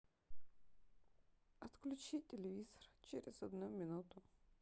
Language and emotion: Russian, sad